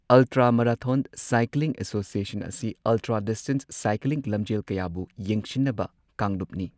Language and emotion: Manipuri, neutral